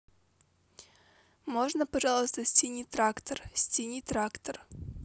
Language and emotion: Russian, neutral